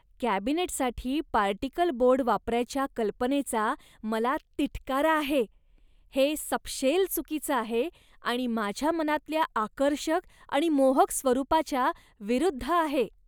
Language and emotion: Marathi, disgusted